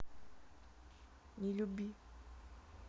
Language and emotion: Russian, sad